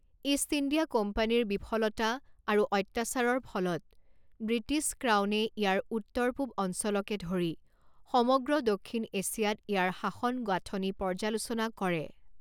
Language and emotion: Assamese, neutral